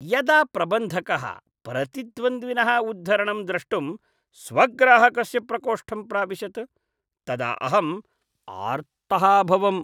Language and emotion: Sanskrit, disgusted